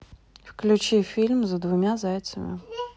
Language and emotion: Russian, neutral